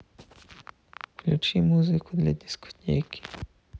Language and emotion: Russian, sad